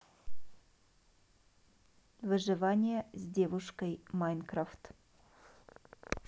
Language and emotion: Russian, neutral